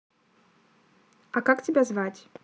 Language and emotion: Russian, neutral